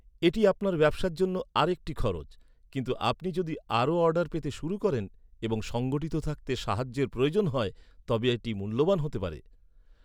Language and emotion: Bengali, neutral